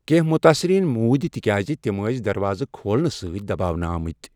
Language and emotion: Kashmiri, neutral